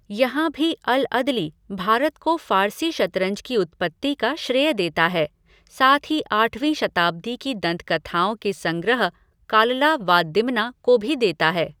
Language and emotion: Hindi, neutral